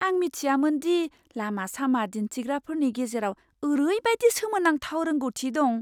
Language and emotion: Bodo, surprised